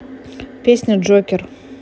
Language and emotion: Russian, neutral